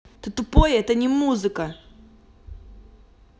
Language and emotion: Russian, angry